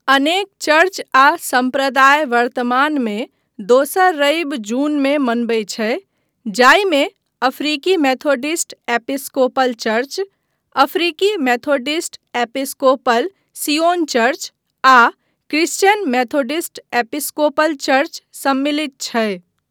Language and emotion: Maithili, neutral